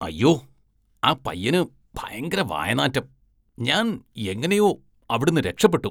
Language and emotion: Malayalam, disgusted